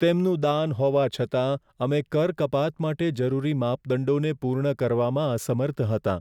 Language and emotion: Gujarati, sad